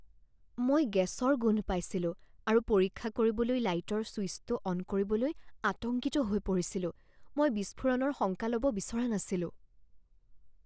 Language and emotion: Assamese, fearful